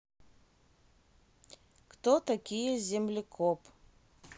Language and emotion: Russian, neutral